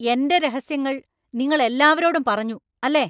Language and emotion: Malayalam, angry